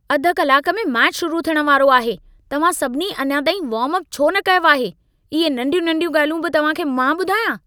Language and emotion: Sindhi, angry